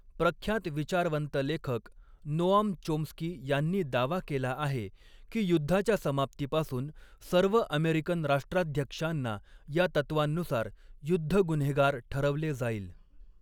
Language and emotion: Marathi, neutral